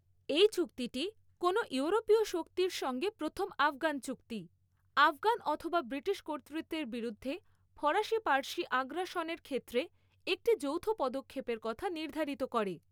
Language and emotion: Bengali, neutral